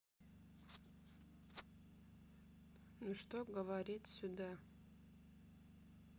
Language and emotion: Russian, sad